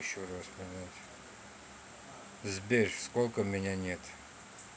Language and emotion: Russian, neutral